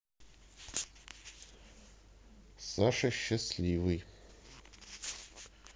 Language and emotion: Russian, neutral